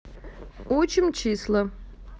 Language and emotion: Russian, neutral